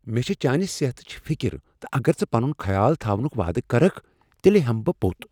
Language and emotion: Kashmiri, fearful